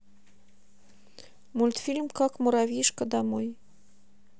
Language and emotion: Russian, neutral